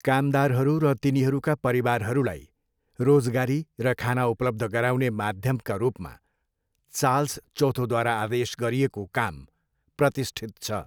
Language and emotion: Nepali, neutral